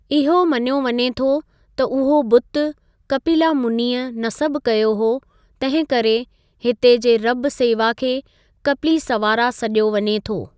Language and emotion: Sindhi, neutral